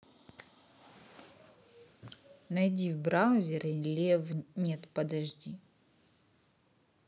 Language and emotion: Russian, neutral